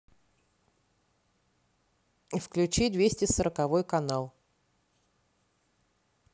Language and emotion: Russian, neutral